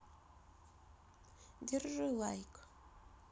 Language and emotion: Russian, neutral